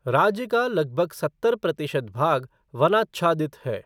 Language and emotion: Hindi, neutral